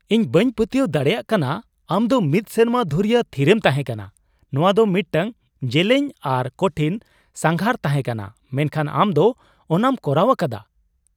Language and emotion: Santali, surprised